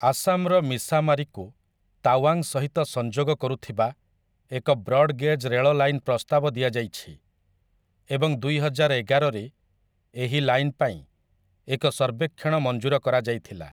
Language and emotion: Odia, neutral